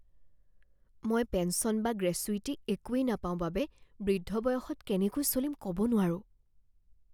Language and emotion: Assamese, fearful